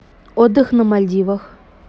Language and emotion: Russian, neutral